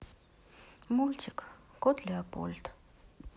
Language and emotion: Russian, sad